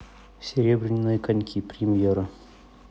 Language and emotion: Russian, neutral